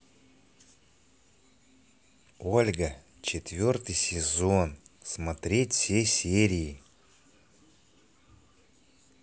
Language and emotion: Russian, positive